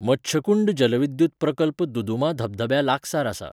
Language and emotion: Goan Konkani, neutral